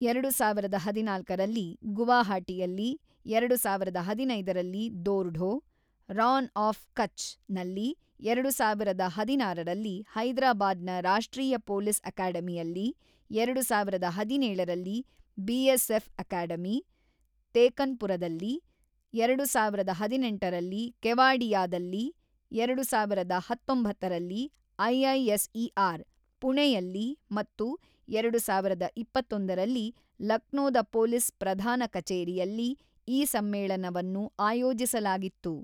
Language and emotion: Kannada, neutral